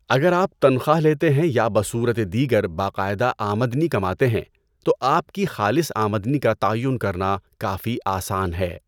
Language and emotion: Urdu, neutral